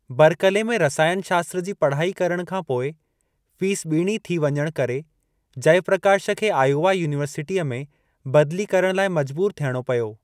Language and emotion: Sindhi, neutral